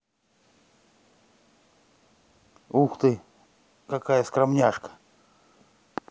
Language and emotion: Russian, neutral